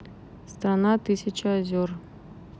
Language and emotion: Russian, neutral